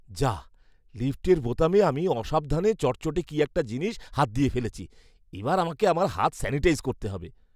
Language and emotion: Bengali, disgusted